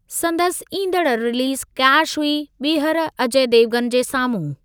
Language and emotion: Sindhi, neutral